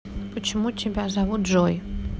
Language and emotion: Russian, neutral